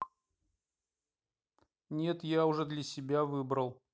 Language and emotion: Russian, neutral